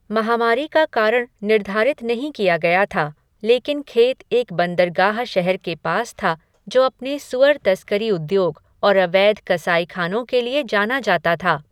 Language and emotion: Hindi, neutral